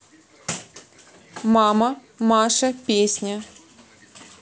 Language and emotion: Russian, neutral